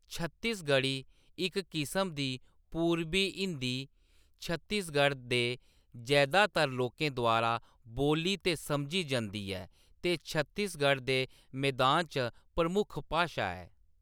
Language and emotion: Dogri, neutral